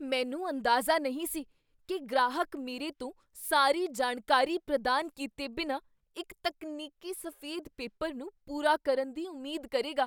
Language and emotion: Punjabi, surprised